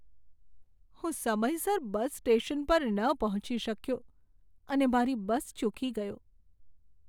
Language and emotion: Gujarati, sad